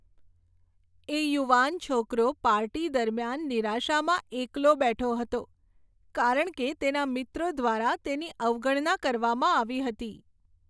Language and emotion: Gujarati, sad